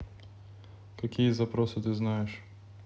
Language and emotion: Russian, neutral